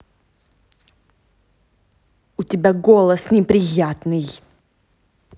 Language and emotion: Russian, angry